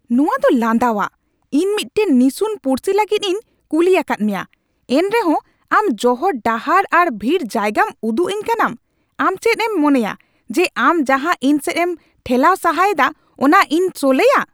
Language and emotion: Santali, angry